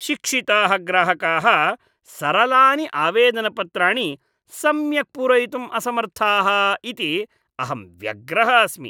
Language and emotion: Sanskrit, disgusted